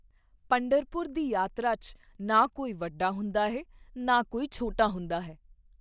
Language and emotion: Punjabi, neutral